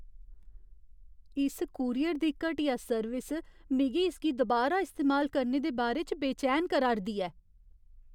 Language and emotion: Dogri, fearful